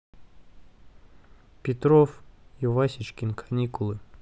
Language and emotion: Russian, neutral